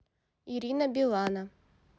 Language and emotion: Russian, neutral